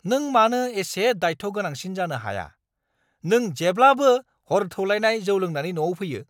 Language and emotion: Bodo, angry